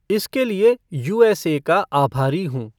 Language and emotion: Hindi, neutral